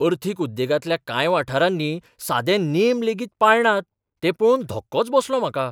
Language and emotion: Goan Konkani, surprised